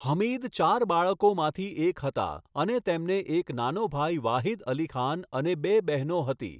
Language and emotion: Gujarati, neutral